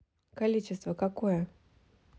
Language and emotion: Russian, neutral